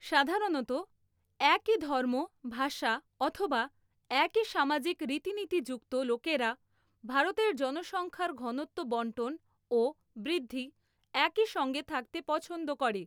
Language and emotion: Bengali, neutral